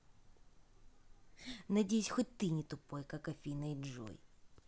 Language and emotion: Russian, angry